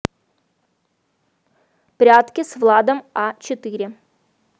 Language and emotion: Russian, neutral